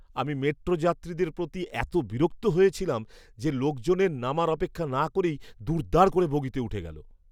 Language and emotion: Bengali, disgusted